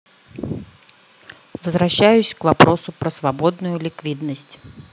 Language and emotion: Russian, neutral